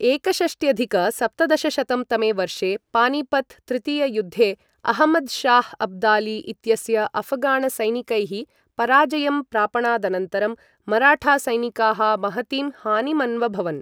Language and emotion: Sanskrit, neutral